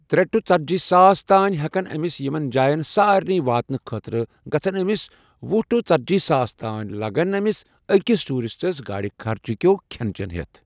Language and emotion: Kashmiri, neutral